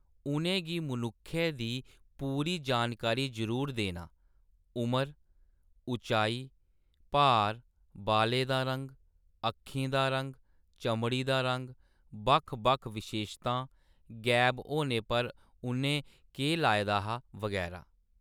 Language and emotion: Dogri, neutral